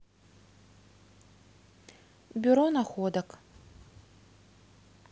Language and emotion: Russian, neutral